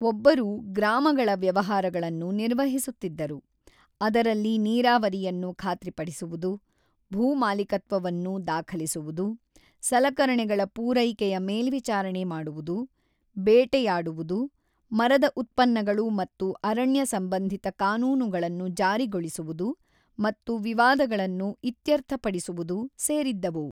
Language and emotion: Kannada, neutral